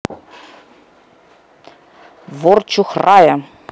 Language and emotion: Russian, neutral